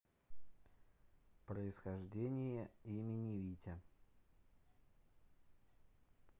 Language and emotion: Russian, neutral